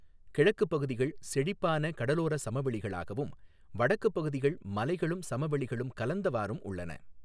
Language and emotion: Tamil, neutral